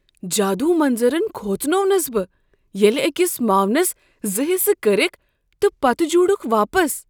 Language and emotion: Kashmiri, surprised